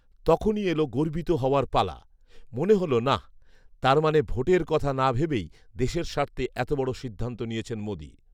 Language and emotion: Bengali, neutral